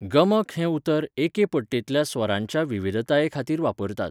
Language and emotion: Goan Konkani, neutral